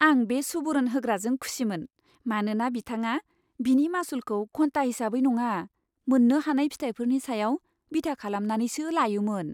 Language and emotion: Bodo, happy